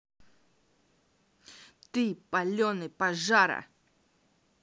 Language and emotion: Russian, angry